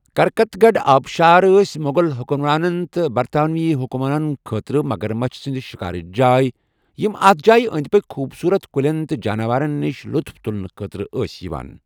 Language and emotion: Kashmiri, neutral